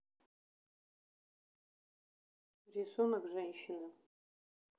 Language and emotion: Russian, neutral